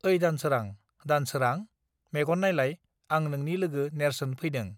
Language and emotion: Bodo, neutral